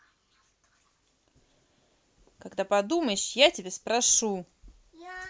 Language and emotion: Russian, angry